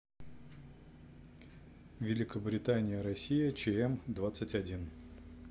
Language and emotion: Russian, neutral